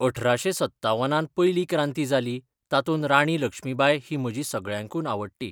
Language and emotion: Goan Konkani, neutral